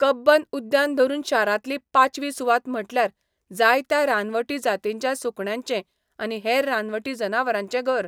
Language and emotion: Goan Konkani, neutral